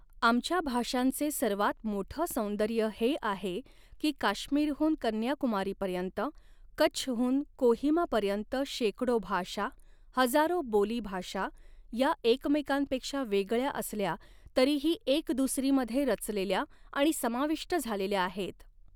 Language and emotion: Marathi, neutral